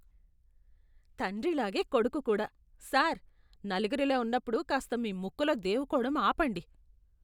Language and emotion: Telugu, disgusted